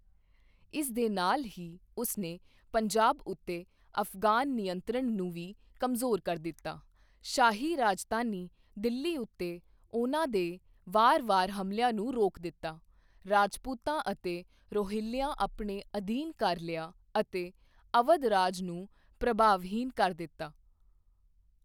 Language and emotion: Punjabi, neutral